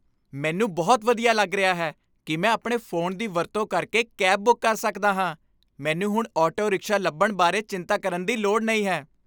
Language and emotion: Punjabi, happy